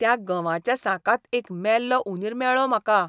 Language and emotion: Goan Konkani, disgusted